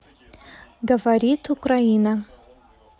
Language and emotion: Russian, neutral